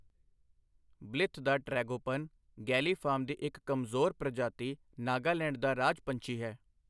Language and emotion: Punjabi, neutral